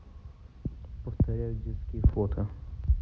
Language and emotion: Russian, neutral